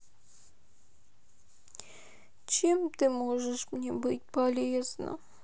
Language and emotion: Russian, sad